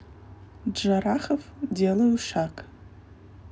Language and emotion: Russian, neutral